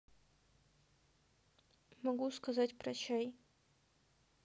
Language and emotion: Russian, sad